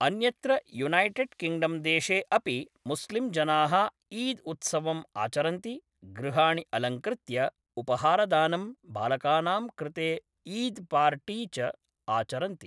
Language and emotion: Sanskrit, neutral